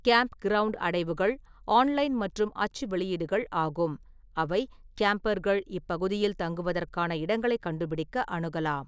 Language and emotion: Tamil, neutral